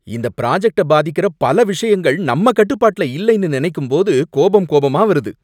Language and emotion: Tamil, angry